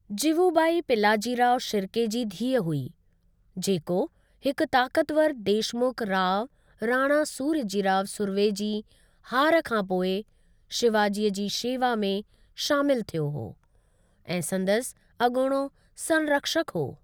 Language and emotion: Sindhi, neutral